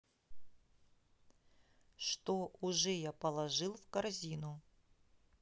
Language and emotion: Russian, neutral